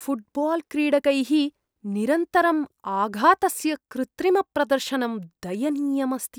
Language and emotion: Sanskrit, disgusted